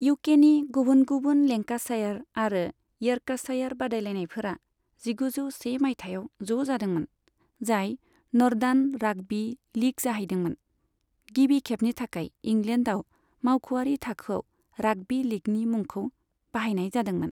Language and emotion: Bodo, neutral